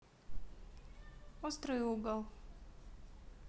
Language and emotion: Russian, neutral